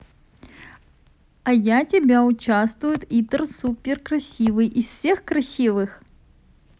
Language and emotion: Russian, positive